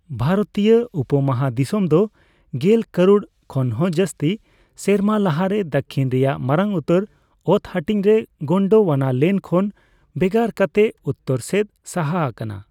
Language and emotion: Santali, neutral